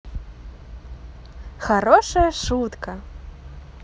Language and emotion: Russian, positive